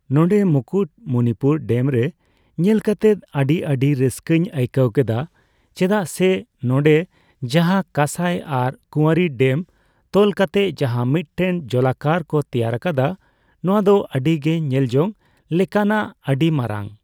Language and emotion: Santali, neutral